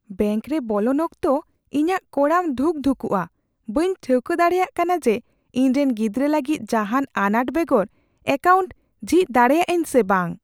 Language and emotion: Santali, fearful